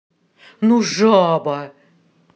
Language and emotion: Russian, angry